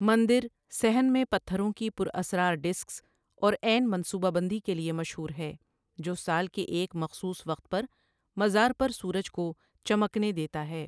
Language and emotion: Urdu, neutral